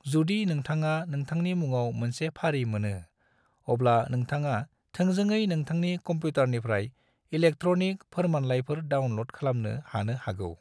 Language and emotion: Bodo, neutral